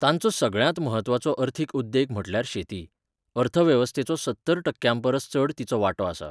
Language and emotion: Goan Konkani, neutral